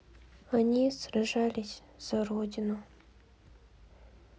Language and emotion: Russian, sad